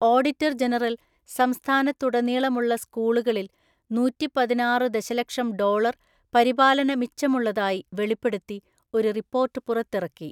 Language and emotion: Malayalam, neutral